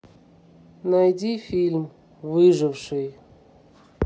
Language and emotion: Russian, neutral